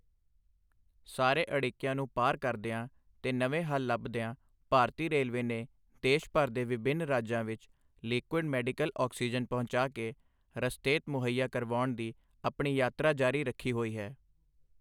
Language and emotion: Punjabi, neutral